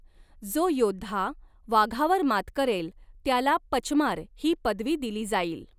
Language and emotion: Marathi, neutral